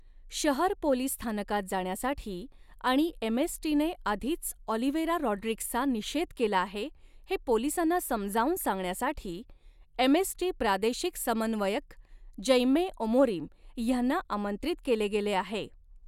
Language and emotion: Marathi, neutral